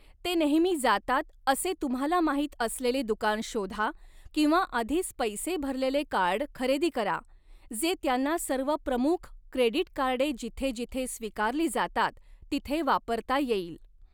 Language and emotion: Marathi, neutral